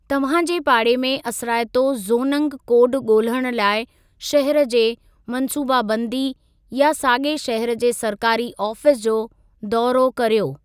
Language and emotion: Sindhi, neutral